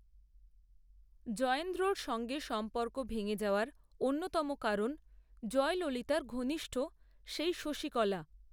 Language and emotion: Bengali, neutral